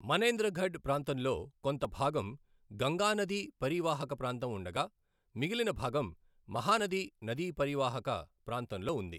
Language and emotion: Telugu, neutral